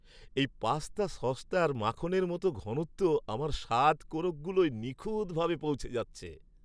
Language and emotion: Bengali, happy